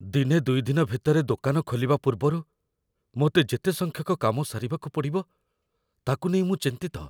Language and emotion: Odia, fearful